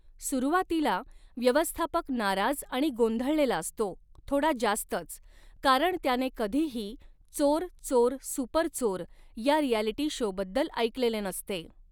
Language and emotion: Marathi, neutral